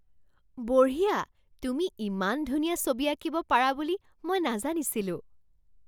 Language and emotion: Assamese, surprised